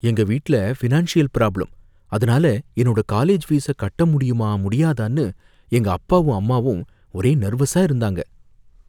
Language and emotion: Tamil, fearful